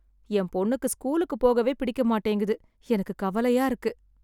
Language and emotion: Tamil, sad